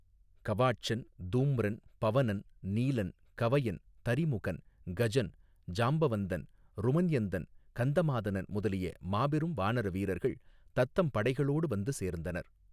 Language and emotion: Tamil, neutral